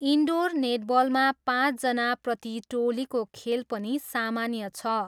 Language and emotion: Nepali, neutral